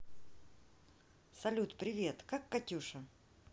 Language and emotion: Russian, neutral